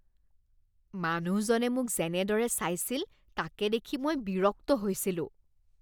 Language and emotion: Assamese, disgusted